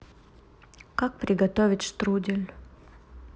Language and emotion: Russian, neutral